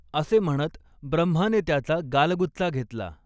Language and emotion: Marathi, neutral